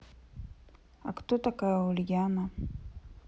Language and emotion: Russian, sad